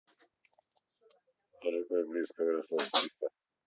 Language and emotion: Russian, neutral